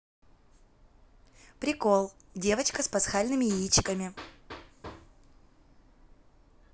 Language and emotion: Russian, positive